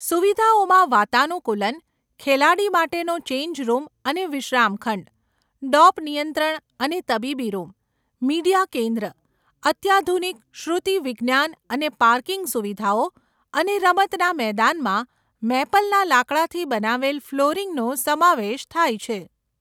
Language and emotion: Gujarati, neutral